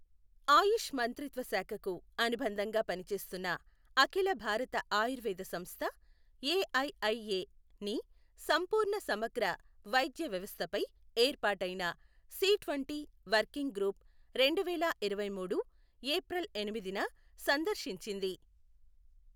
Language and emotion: Telugu, neutral